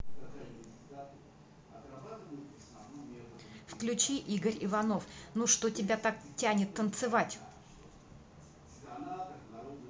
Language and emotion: Russian, neutral